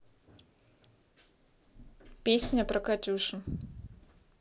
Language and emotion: Russian, neutral